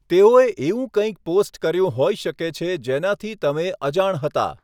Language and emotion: Gujarati, neutral